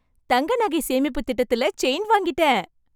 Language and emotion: Tamil, happy